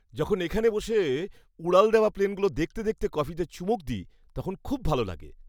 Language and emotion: Bengali, happy